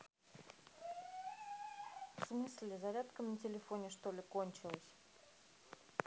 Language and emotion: Russian, neutral